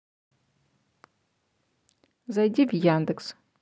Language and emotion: Russian, neutral